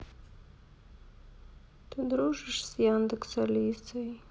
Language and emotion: Russian, sad